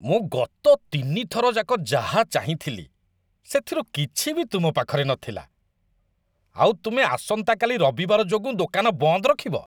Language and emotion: Odia, disgusted